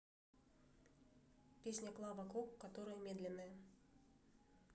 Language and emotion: Russian, neutral